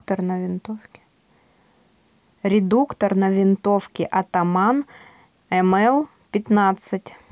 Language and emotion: Russian, neutral